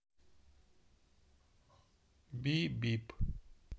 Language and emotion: Russian, neutral